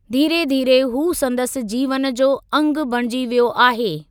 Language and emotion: Sindhi, neutral